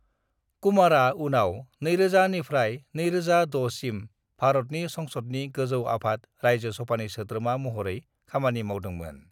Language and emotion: Bodo, neutral